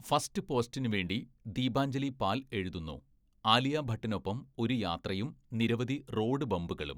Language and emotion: Malayalam, neutral